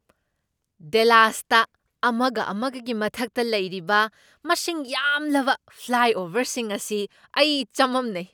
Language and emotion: Manipuri, surprised